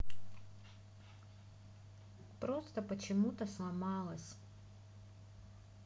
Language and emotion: Russian, sad